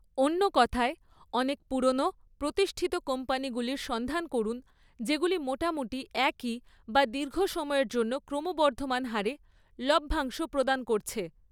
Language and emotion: Bengali, neutral